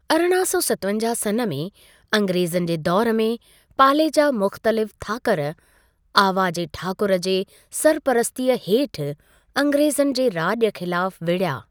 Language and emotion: Sindhi, neutral